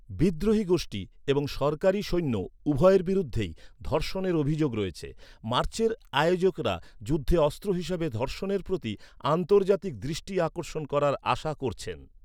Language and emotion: Bengali, neutral